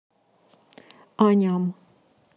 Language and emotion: Russian, neutral